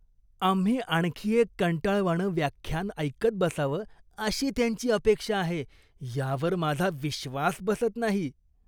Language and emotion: Marathi, disgusted